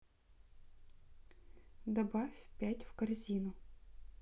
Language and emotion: Russian, neutral